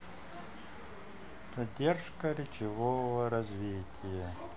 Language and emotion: Russian, neutral